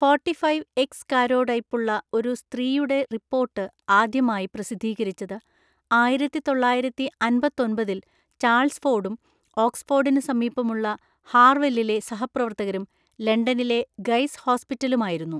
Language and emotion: Malayalam, neutral